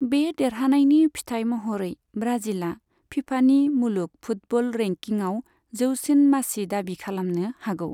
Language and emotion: Bodo, neutral